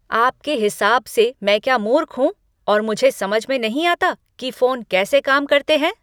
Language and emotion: Hindi, angry